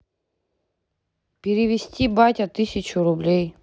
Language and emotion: Russian, neutral